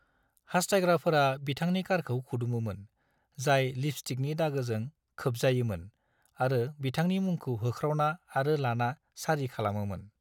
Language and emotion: Bodo, neutral